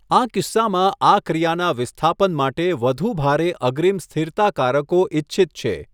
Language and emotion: Gujarati, neutral